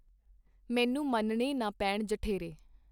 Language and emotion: Punjabi, neutral